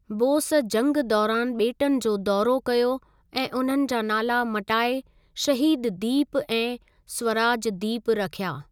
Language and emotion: Sindhi, neutral